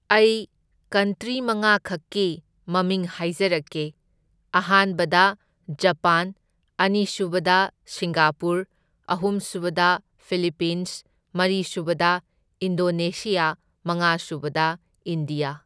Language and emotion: Manipuri, neutral